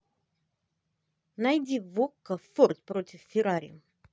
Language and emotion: Russian, positive